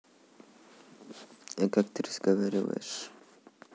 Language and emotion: Russian, neutral